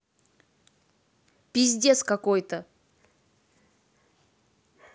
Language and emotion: Russian, angry